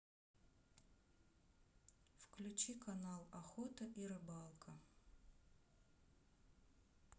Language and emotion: Russian, sad